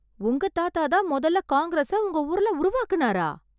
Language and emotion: Tamil, surprised